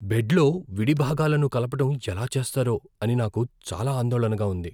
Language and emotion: Telugu, fearful